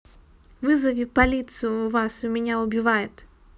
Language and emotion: Russian, neutral